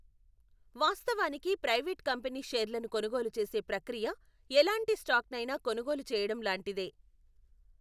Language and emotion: Telugu, neutral